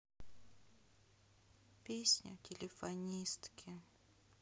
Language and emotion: Russian, sad